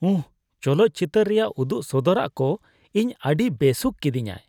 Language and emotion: Santali, disgusted